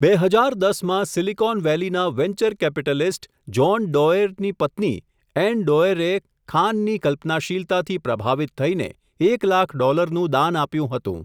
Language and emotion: Gujarati, neutral